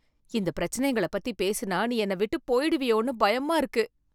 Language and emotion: Tamil, fearful